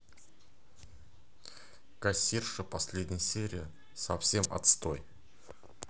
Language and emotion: Russian, neutral